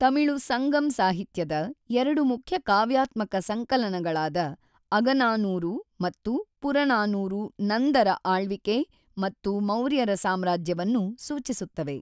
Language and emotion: Kannada, neutral